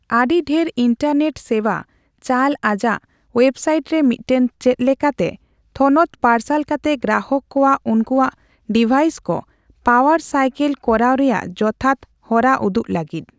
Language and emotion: Santali, neutral